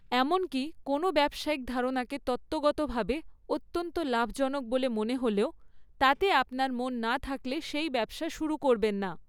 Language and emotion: Bengali, neutral